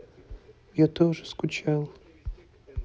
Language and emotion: Russian, sad